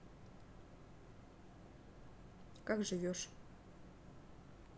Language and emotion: Russian, neutral